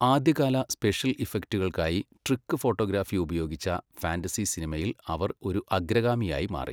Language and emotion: Malayalam, neutral